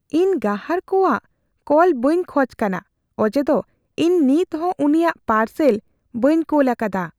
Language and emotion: Santali, fearful